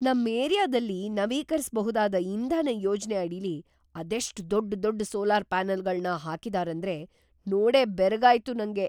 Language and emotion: Kannada, surprised